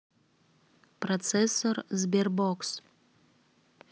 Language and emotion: Russian, neutral